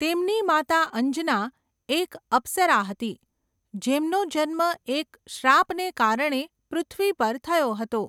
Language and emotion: Gujarati, neutral